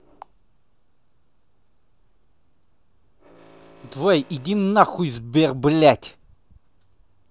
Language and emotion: Russian, angry